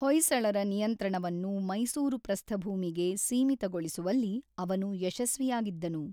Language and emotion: Kannada, neutral